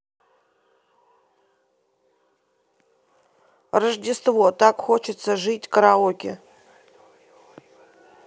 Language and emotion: Russian, neutral